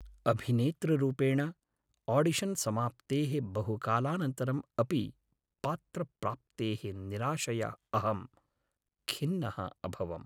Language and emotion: Sanskrit, sad